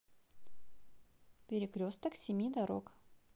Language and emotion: Russian, positive